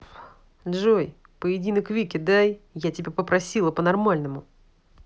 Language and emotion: Russian, angry